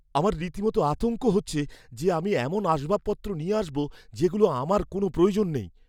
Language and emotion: Bengali, fearful